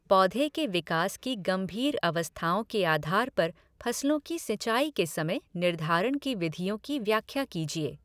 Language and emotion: Hindi, neutral